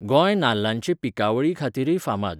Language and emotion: Goan Konkani, neutral